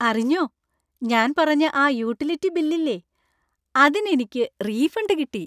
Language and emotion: Malayalam, happy